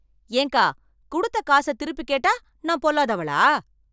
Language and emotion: Tamil, angry